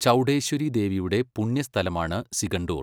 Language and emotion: Malayalam, neutral